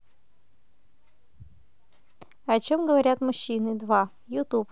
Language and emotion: Russian, neutral